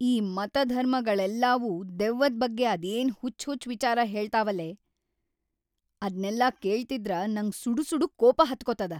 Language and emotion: Kannada, angry